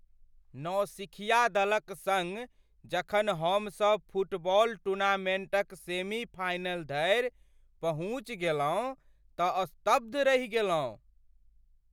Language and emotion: Maithili, surprised